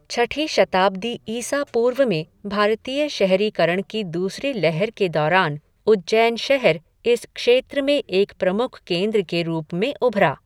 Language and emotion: Hindi, neutral